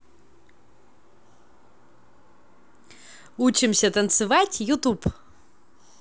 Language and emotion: Russian, positive